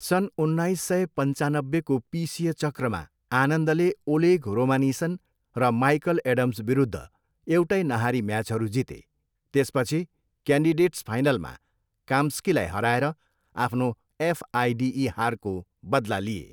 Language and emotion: Nepali, neutral